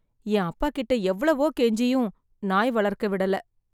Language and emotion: Tamil, sad